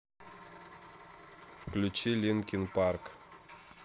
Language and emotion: Russian, neutral